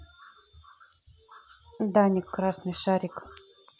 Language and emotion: Russian, neutral